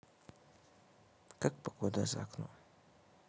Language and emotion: Russian, sad